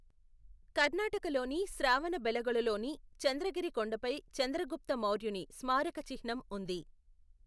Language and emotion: Telugu, neutral